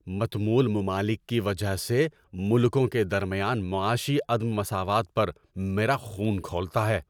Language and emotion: Urdu, angry